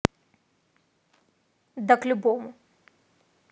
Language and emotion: Russian, neutral